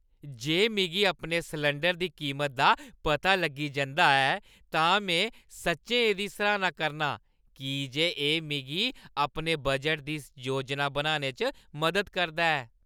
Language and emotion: Dogri, happy